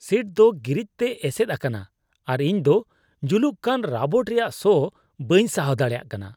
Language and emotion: Santali, disgusted